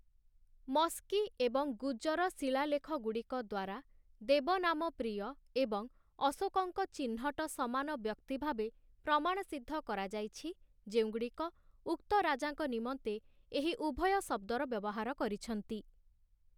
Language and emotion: Odia, neutral